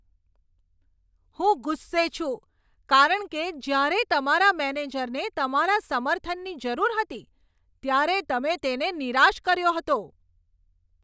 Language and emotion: Gujarati, angry